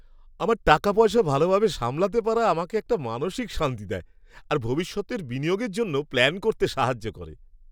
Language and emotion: Bengali, happy